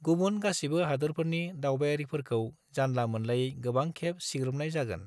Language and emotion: Bodo, neutral